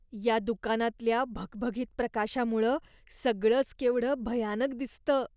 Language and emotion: Marathi, disgusted